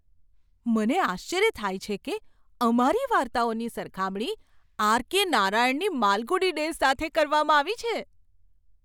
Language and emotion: Gujarati, surprised